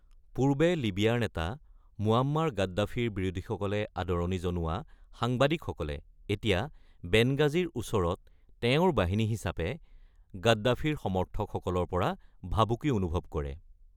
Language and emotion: Assamese, neutral